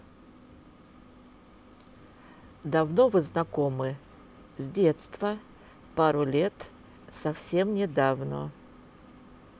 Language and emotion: Russian, neutral